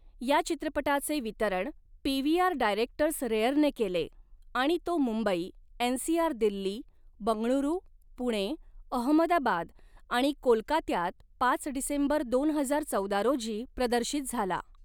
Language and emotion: Marathi, neutral